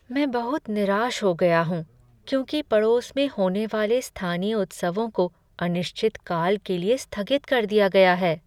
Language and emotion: Hindi, sad